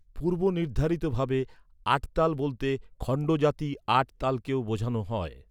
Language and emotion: Bengali, neutral